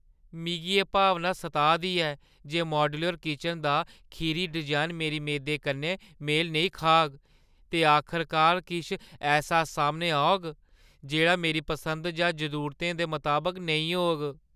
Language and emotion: Dogri, fearful